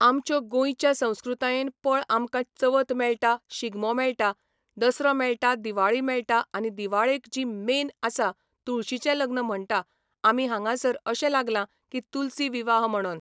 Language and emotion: Goan Konkani, neutral